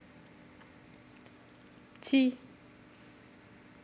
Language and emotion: Russian, neutral